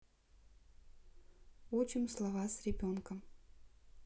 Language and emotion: Russian, neutral